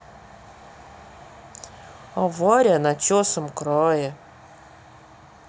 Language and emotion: Russian, sad